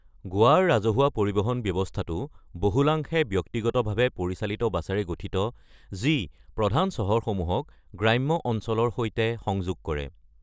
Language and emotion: Assamese, neutral